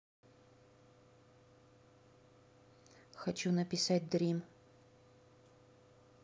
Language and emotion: Russian, neutral